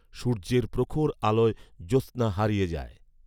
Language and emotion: Bengali, neutral